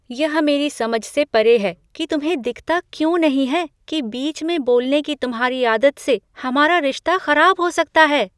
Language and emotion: Hindi, surprised